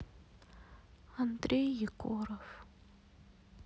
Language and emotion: Russian, sad